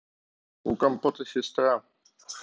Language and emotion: Russian, neutral